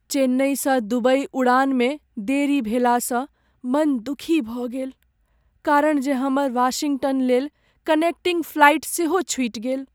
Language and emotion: Maithili, sad